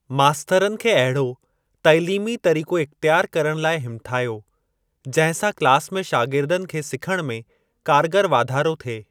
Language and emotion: Sindhi, neutral